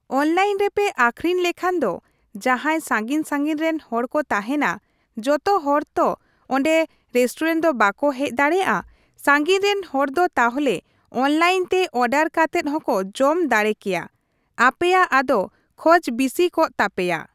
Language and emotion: Santali, neutral